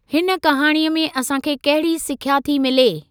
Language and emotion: Sindhi, neutral